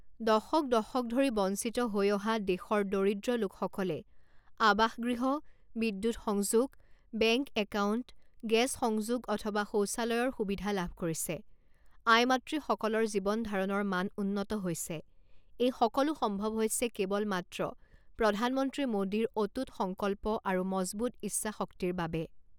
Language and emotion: Assamese, neutral